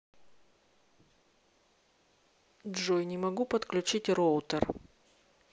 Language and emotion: Russian, neutral